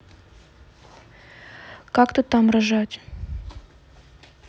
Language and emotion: Russian, neutral